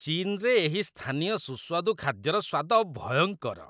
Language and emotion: Odia, disgusted